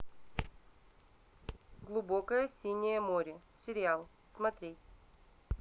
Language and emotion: Russian, neutral